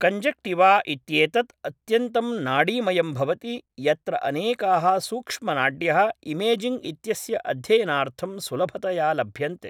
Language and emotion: Sanskrit, neutral